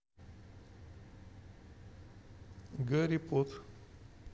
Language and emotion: Russian, neutral